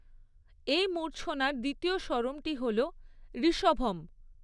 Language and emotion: Bengali, neutral